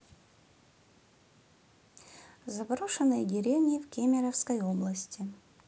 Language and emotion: Russian, neutral